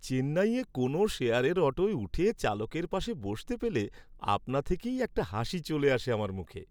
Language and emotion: Bengali, happy